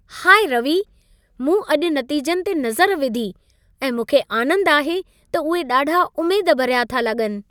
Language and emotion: Sindhi, happy